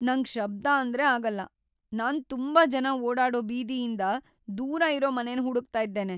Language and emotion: Kannada, fearful